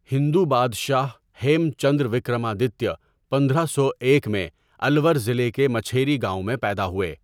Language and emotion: Urdu, neutral